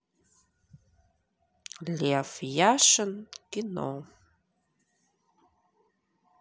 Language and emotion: Russian, neutral